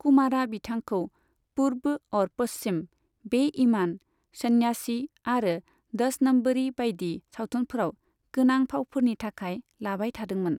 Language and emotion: Bodo, neutral